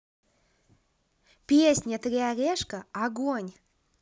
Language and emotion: Russian, positive